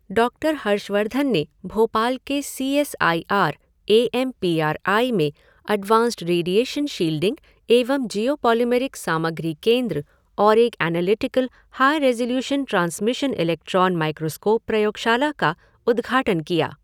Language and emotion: Hindi, neutral